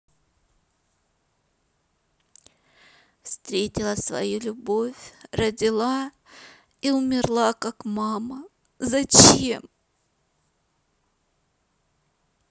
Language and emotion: Russian, sad